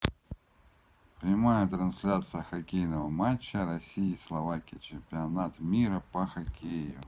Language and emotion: Russian, neutral